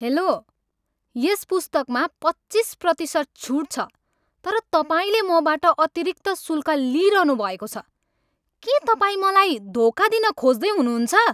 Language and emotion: Nepali, angry